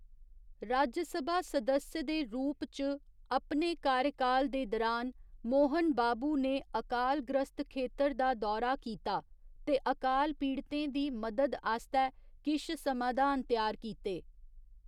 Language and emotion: Dogri, neutral